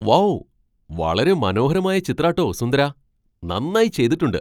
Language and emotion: Malayalam, surprised